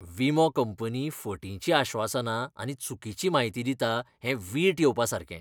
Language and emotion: Goan Konkani, disgusted